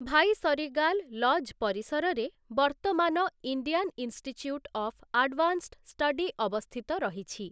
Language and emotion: Odia, neutral